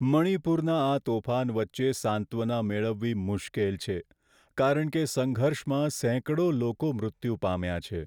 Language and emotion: Gujarati, sad